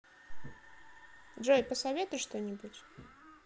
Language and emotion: Russian, neutral